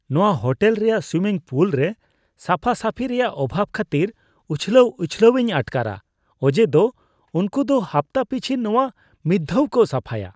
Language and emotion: Santali, disgusted